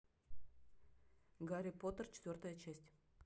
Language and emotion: Russian, neutral